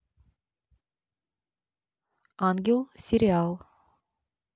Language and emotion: Russian, neutral